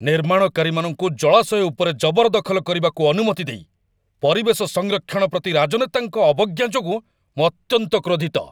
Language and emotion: Odia, angry